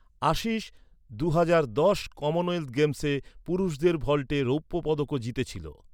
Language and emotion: Bengali, neutral